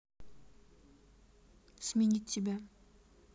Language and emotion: Russian, neutral